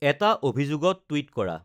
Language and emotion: Assamese, neutral